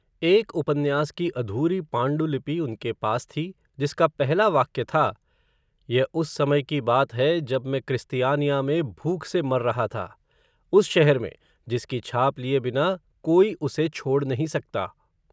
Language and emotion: Hindi, neutral